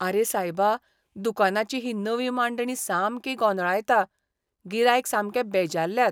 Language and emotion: Goan Konkani, disgusted